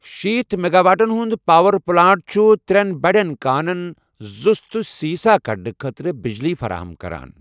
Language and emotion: Kashmiri, neutral